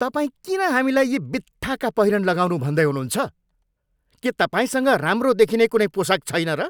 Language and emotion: Nepali, angry